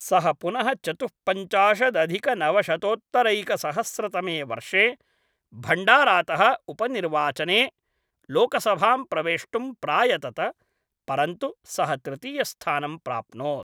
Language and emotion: Sanskrit, neutral